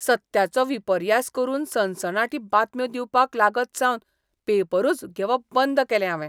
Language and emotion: Goan Konkani, disgusted